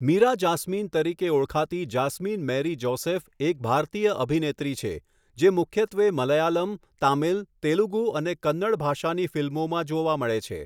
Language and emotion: Gujarati, neutral